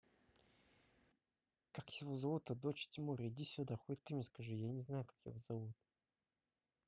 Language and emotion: Russian, neutral